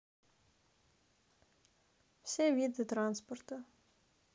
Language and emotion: Russian, neutral